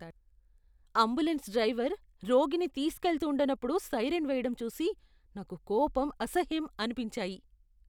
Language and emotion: Telugu, disgusted